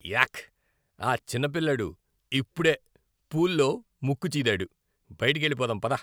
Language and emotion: Telugu, disgusted